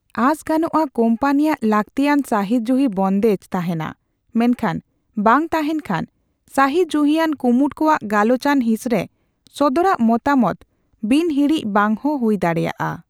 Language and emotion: Santali, neutral